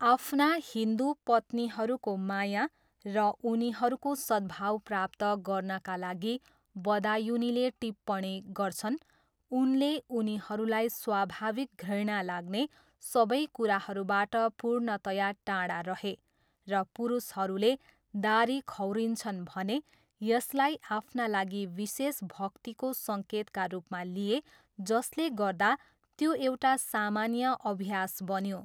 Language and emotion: Nepali, neutral